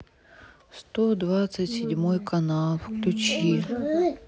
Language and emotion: Russian, sad